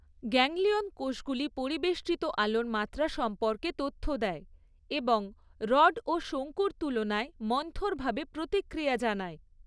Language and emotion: Bengali, neutral